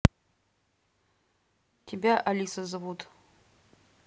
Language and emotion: Russian, neutral